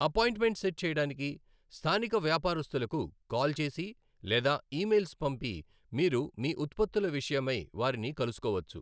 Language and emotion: Telugu, neutral